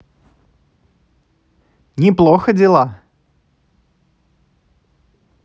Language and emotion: Russian, positive